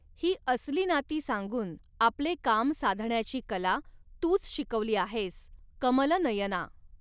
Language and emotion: Marathi, neutral